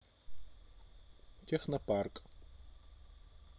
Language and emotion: Russian, neutral